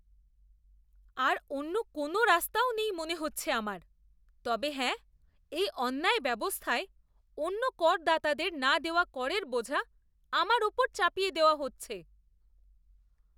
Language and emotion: Bengali, disgusted